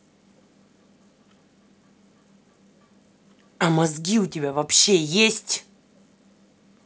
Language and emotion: Russian, angry